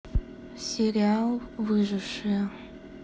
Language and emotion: Russian, neutral